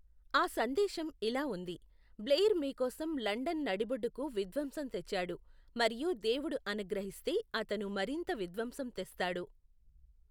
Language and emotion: Telugu, neutral